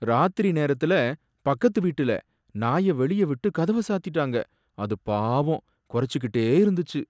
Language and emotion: Tamil, sad